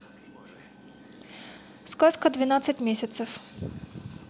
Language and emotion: Russian, neutral